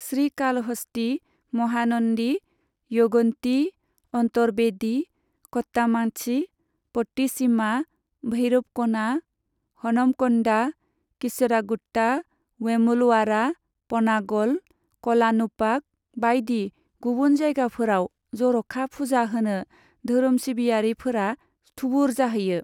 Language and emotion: Bodo, neutral